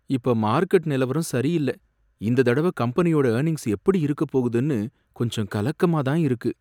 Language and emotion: Tamil, fearful